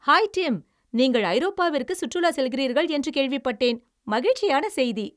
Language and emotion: Tamil, happy